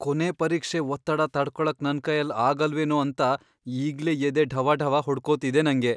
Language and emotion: Kannada, fearful